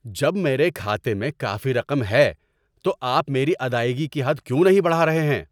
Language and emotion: Urdu, angry